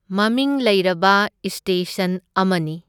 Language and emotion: Manipuri, neutral